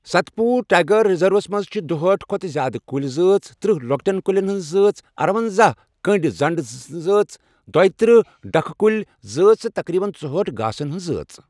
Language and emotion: Kashmiri, neutral